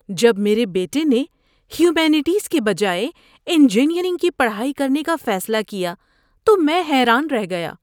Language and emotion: Urdu, surprised